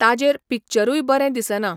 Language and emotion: Goan Konkani, neutral